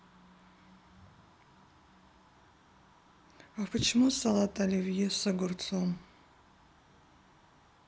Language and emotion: Russian, neutral